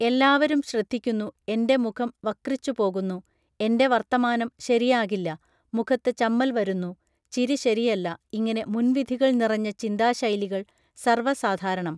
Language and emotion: Malayalam, neutral